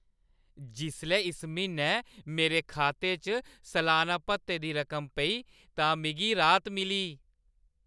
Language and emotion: Dogri, happy